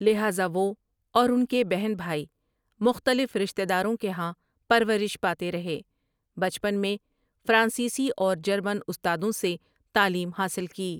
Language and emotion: Urdu, neutral